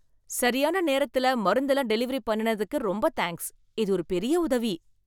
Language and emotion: Tamil, happy